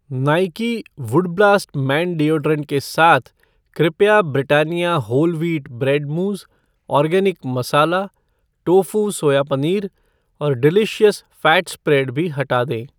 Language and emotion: Hindi, neutral